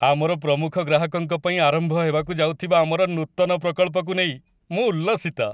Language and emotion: Odia, happy